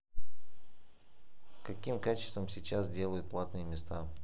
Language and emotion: Russian, neutral